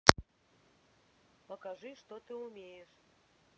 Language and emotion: Russian, neutral